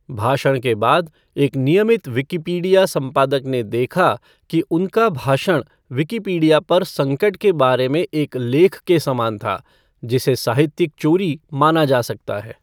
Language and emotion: Hindi, neutral